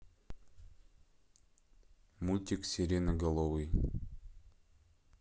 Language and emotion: Russian, neutral